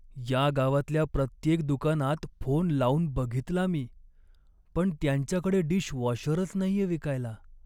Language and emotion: Marathi, sad